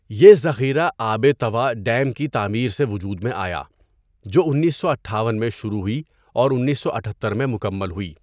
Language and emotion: Urdu, neutral